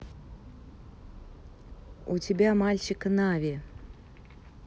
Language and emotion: Russian, neutral